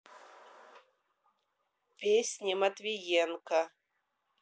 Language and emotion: Russian, neutral